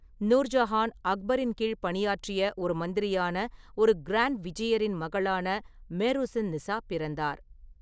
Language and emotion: Tamil, neutral